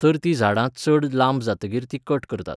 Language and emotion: Goan Konkani, neutral